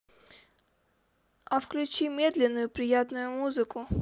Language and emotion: Russian, neutral